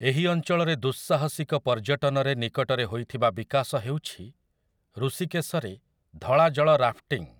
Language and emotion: Odia, neutral